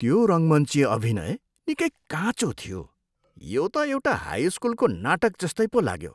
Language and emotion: Nepali, disgusted